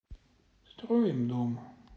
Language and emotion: Russian, sad